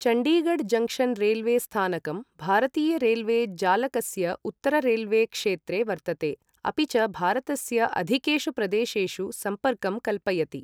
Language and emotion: Sanskrit, neutral